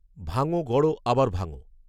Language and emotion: Bengali, neutral